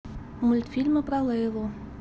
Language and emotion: Russian, neutral